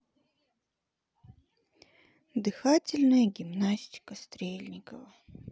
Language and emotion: Russian, sad